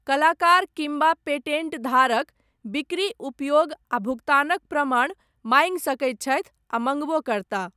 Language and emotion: Maithili, neutral